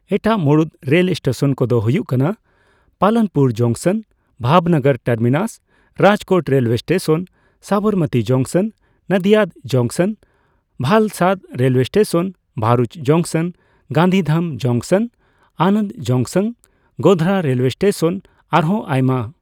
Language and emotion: Santali, neutral